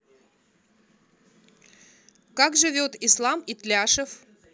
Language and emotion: Russian, neutral